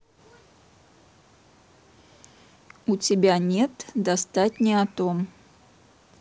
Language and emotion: Russian, neutral